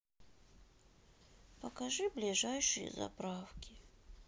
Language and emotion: Russian, sad